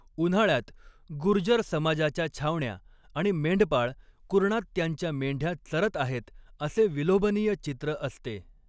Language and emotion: Marathi, neutral